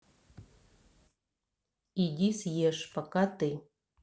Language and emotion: Russian, neutral